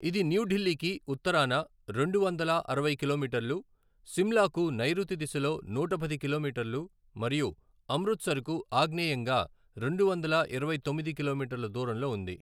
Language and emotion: Telugu, neutral